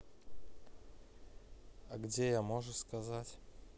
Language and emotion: Russian, neutral